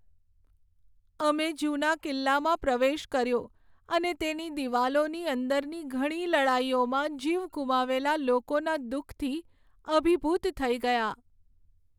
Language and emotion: Gujarati, sad